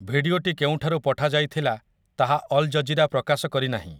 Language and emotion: Odia, neutral